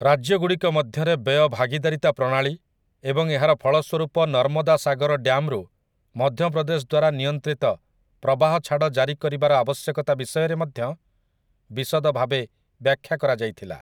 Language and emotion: Odia, neutral